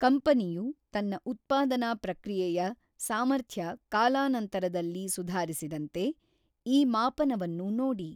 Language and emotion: Kannada, neutral